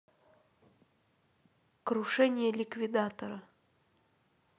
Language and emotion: Russian, neutral